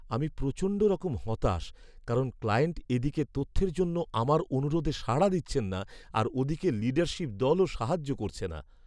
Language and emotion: Bengali, sad